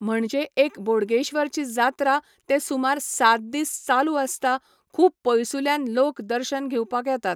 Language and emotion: Goan Konkani, neutral